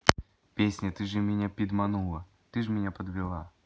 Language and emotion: Russian, neutral